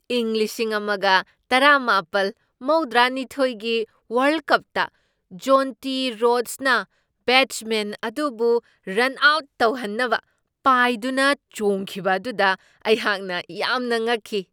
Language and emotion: Manipuri, surprised